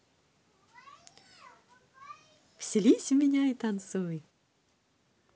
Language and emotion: Russian, positive